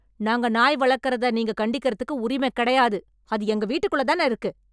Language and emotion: Tamil, angry